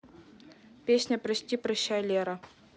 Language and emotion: Russian, neutral